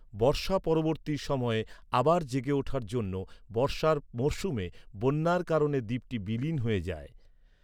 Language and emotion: Bengali, neutral